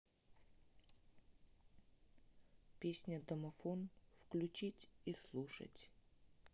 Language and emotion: Russian, neutral